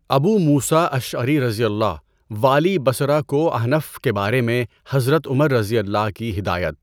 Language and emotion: Urdu, neutral